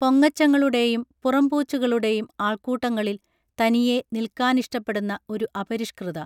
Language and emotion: Malayalam, neutral